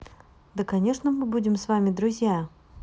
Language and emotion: Russian, neutral